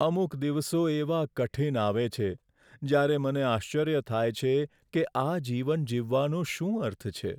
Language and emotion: Gujarati, sad